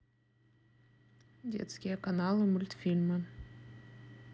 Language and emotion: Russian, neutral